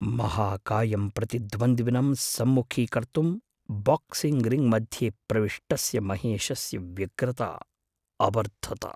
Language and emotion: Sanskrit, fearful